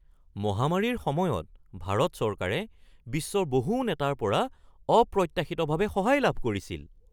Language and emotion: Assamese, surprised